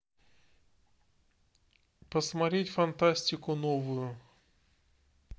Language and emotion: Russian, neutral